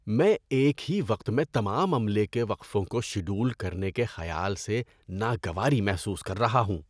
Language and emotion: Urdu, disgusted